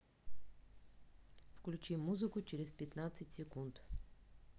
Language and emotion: Russian, neutral